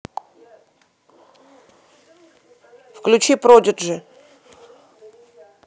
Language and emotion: Russian, neutral